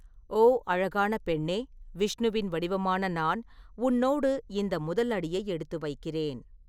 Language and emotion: Tamil, neutral